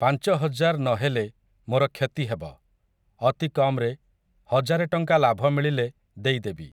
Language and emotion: Odia, neutral